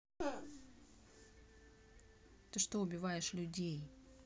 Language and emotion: Russian, neutral